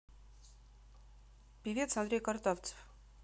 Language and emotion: Russian, neutral